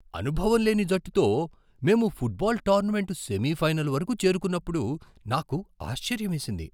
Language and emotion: Telugu, surprised